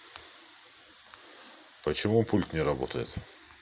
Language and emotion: Russian, neutral